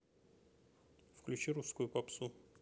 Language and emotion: Russian, neutral